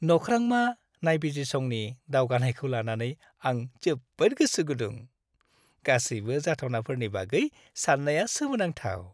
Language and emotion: Bodo, happy